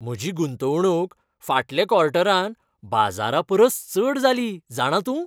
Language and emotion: Goan Konkani, happy